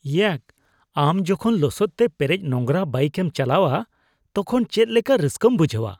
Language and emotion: Santali, disgusted